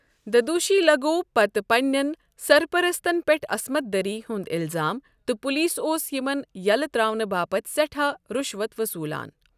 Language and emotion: Kashmiri, neutral